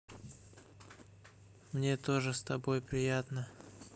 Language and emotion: Russian, neutral